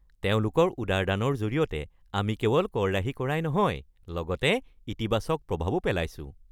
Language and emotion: Assamese, happy